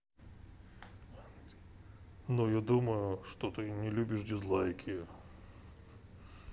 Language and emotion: Russian, neutral